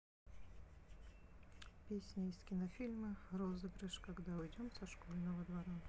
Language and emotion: Russian, neutral